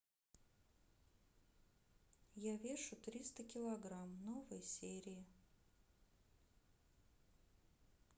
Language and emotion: Russian, neutral